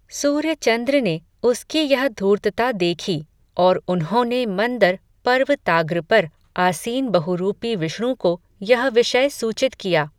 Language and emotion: Hindi, neutral